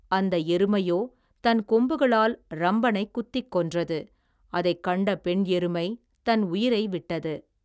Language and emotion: Tamil, neutral